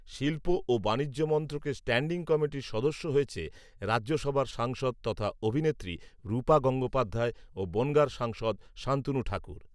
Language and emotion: Bengali, neutral